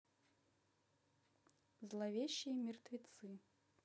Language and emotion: Russian, neutral